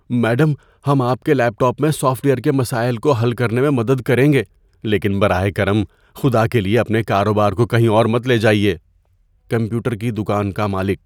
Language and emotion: Urdu, fearful